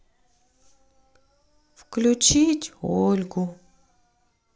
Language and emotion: Russian, sad